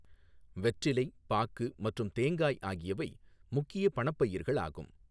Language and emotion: Tamil, neutral